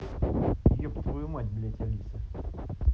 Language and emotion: Russian, angry